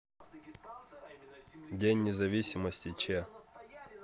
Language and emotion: Russian, neutral